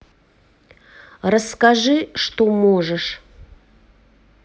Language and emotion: Russian, neutral